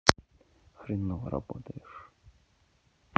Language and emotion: Russian, neutral